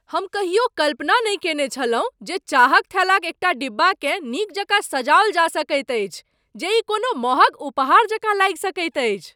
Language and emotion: Maithili, surprised